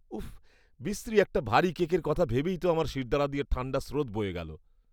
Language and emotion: Bengali, disgusted